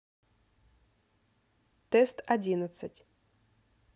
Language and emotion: Russian, neutral